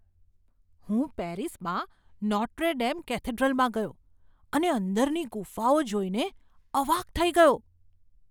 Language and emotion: Gujarati, surprised